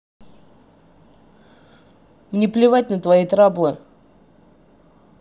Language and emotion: Russian, angry